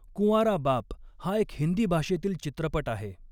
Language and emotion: Marathi, neutral